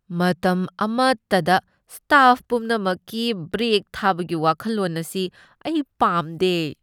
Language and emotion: Manipuri, disgusted